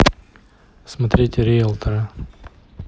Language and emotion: Russian, neutral